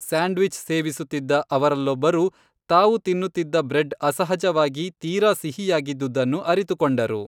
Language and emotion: Kannada, neutral